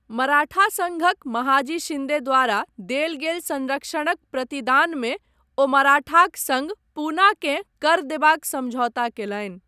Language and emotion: Maithili, neutral